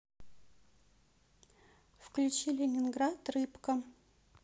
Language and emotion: Russian, neutral